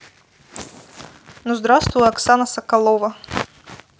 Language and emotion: Russian, neutral